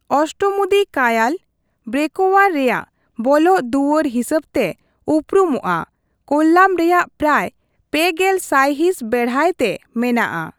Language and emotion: Santali, neutral